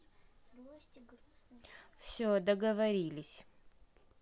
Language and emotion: Russian, neutral